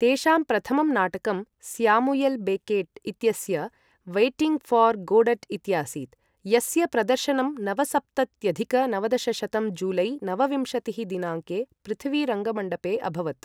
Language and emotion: Sanskrit, neutral